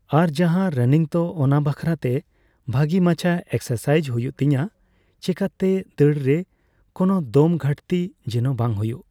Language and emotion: Santali, neutral